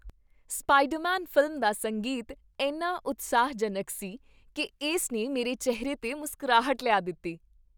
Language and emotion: Punjabi, happy